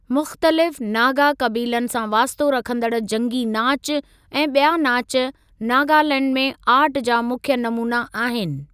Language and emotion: Sindhi, neutral